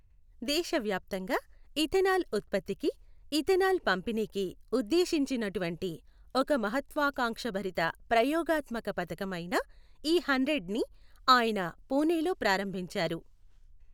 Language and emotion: Telugu, neutral